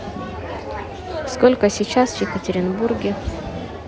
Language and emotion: Russian, neutral